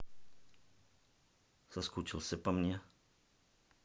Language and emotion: Russian, neutral